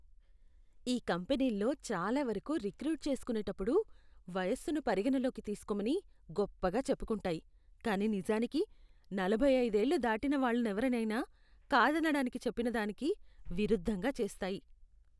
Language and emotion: Telugu, disgusted